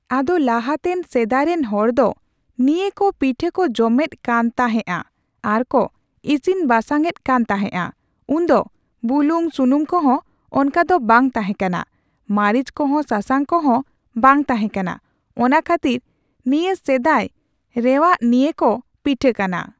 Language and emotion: Santali, neutral